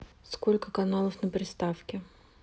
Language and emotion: Russian, neutral